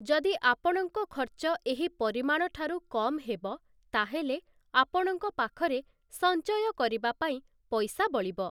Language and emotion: Odia, neutral